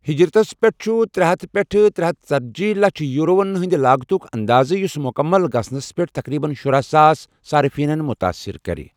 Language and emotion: Kashmiri, neutral